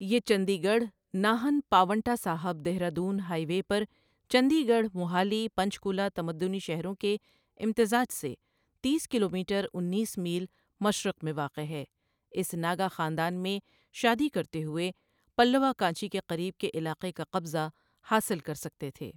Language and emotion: Urdu, neutral